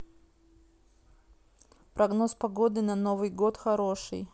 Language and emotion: Russian, neutral